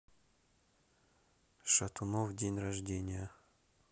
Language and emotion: Russian, neutral